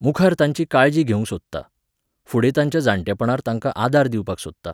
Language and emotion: Goan Konkani, neutral